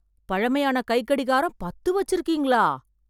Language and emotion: Tamil, surprised